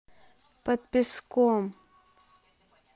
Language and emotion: Russian, neutral